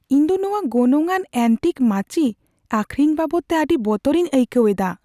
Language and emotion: Santali, fearful